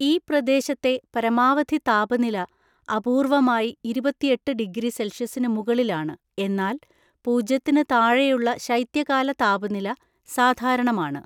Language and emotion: Malayalam, neutral